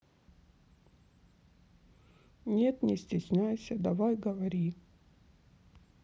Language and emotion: Russian, sad